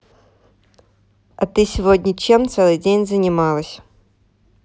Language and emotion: Russian, neutral